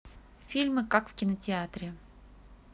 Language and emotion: Russian, neutral